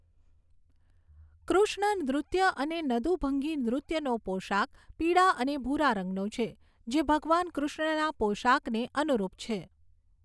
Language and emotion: Gujarati, neutral